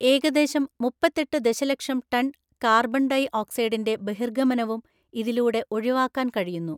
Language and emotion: Malayalam, neutral